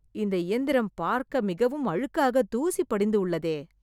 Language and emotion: Tamil, disgusted